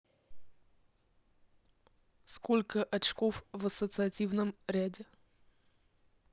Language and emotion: Russian, neutral